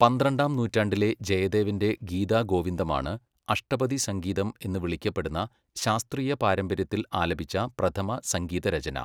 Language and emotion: Malayalam, neutral